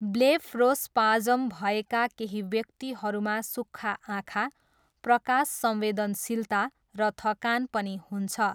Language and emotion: Nepali, neutral